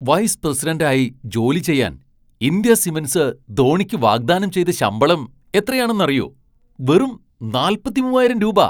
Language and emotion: Malayalam, surprised